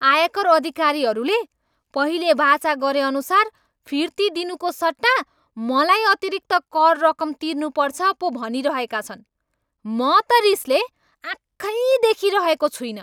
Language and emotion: Nepali, angry